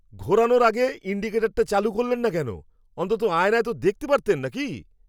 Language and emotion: Bengali, angry